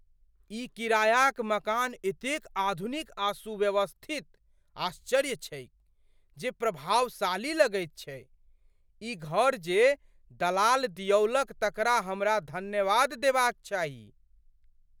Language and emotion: Maithili, surprised